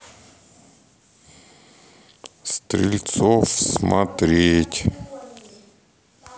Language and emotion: Russian, neutral